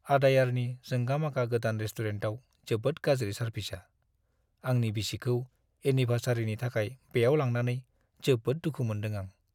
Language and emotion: Bodo, sad